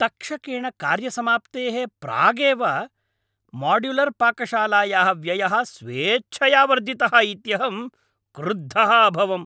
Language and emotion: Sanskrit, angry